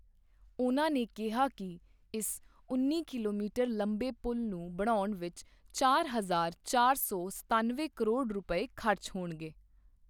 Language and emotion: Punjabi, neutral